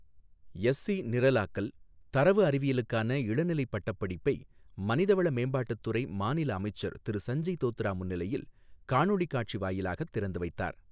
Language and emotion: Tamil, neutral